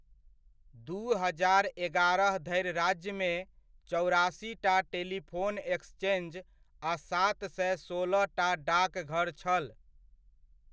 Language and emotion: Maithili, neutral